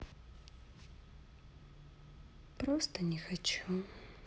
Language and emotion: Russian, sad